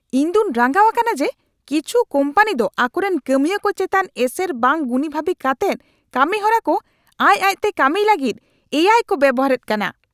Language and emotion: Santali, angry